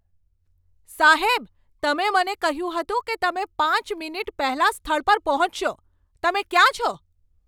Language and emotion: Gujarati, angry